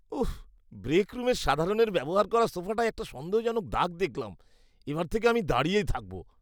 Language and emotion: Bengali, disgusted